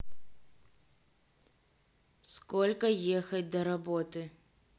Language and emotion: Russian, neutral